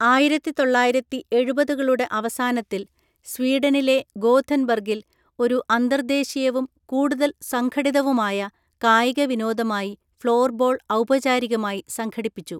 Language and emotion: Malayalam, neutral